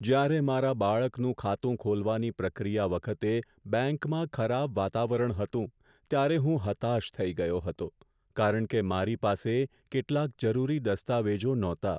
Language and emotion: Gujarati, sad